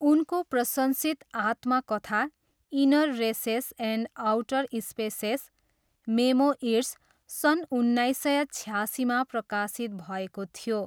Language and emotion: Nepali, neutral